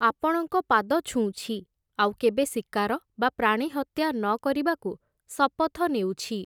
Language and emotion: Odia, neutral